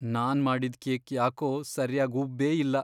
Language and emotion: Kannada, sad